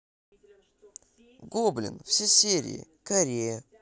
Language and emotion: Russian, positive